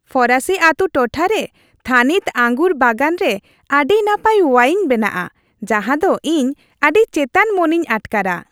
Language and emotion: Santali, happy